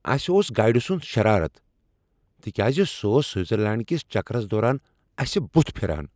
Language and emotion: Kashmiri, angry